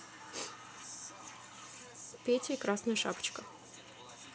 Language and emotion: Russian, neutral